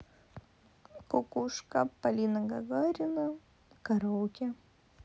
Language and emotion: Russian, neutral